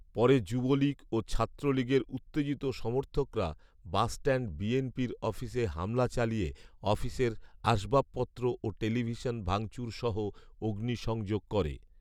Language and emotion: Bengali, neutral